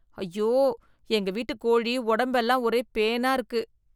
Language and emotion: Tamil, disgusted